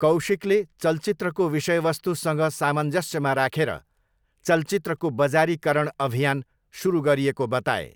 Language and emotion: Nepali, neutral